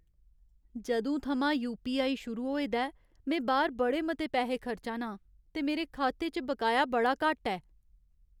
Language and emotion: Dogri, sad